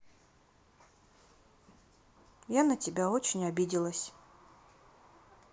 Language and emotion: Russian, sad